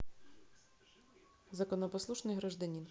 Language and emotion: Russian, neutral